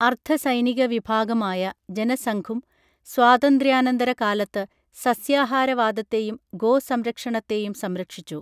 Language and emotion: Malayalam, neutral